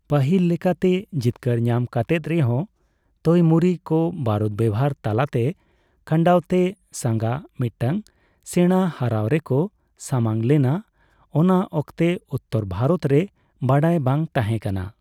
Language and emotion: Santali, neutral